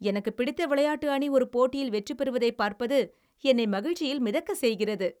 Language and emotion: Tamil, happy